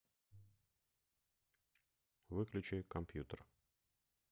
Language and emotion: Russian, neutral